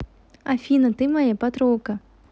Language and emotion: Russian, positive